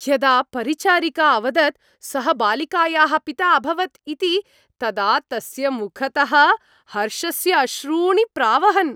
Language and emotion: Sanskrit, happy